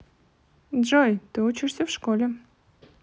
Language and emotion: Russian, neutral